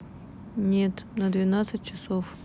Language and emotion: Russian, neutral